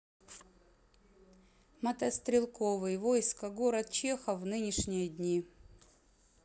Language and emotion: Russian, neutral